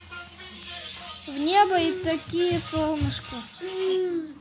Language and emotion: Russian, neutral